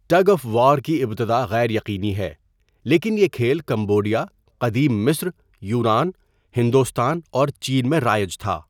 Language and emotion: Urdu, neutral